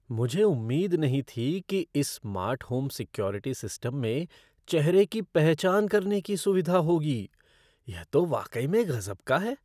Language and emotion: Hindi, surprised